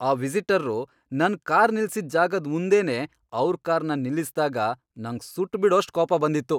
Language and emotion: Kannada, angry